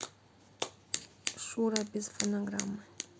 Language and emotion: Russian, neutral